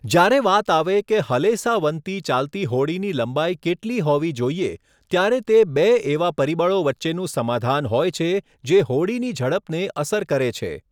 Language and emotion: Gujarati, neutral